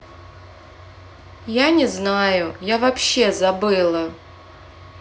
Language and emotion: Russian, sad